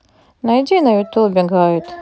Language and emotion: Russian, neutral